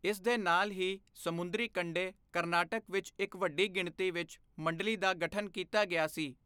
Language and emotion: Punjabi, neutral